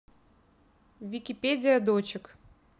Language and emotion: Russian, neutral